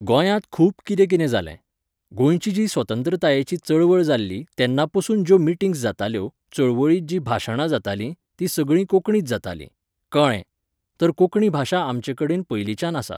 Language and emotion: Goan Konkani, neutral